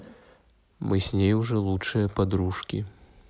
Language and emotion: Russian, neutral